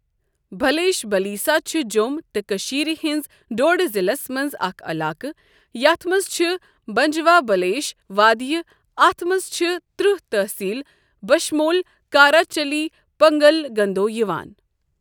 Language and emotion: Kashmiri, neutral